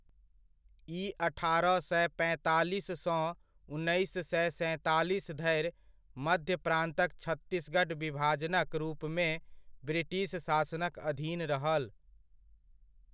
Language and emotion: Maithili, neutral